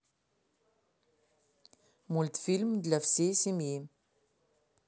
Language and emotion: Russian, neutral